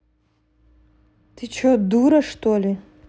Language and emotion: Russian, angry